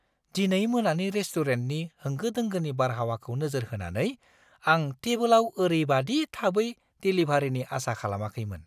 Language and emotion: Bodo, surprised